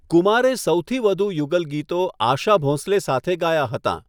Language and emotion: Gujarati, neutral